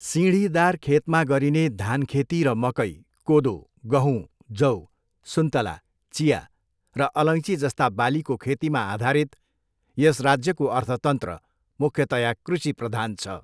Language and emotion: Nepali, neutral